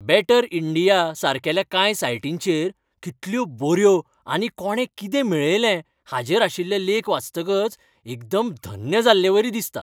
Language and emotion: Goan Konkani, happy